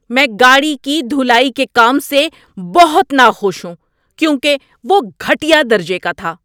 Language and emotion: Urdu, angry